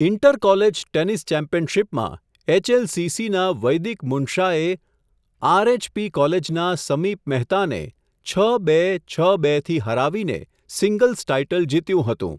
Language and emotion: Gujarati, neutral